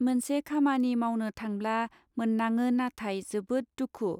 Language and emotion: Bodo, neutral